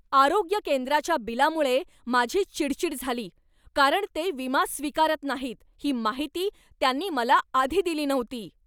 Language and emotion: Marathi, angry